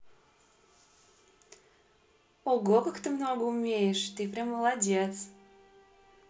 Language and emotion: Russian, positive